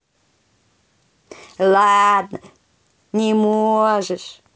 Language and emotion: Russian, positive